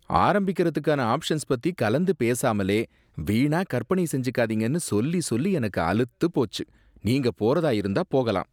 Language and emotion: Tamil, disgusted